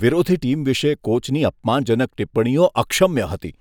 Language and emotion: Gujarati, disgusted